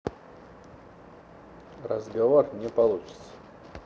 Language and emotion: Russian, neutral